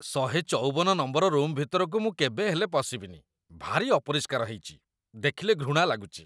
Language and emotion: Odia, disgusted